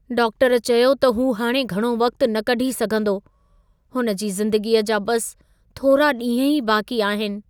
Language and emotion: Sindhi, sad